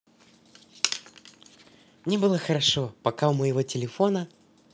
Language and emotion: Russian, positive